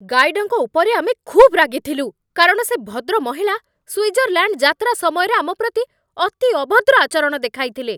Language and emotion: Odia, angry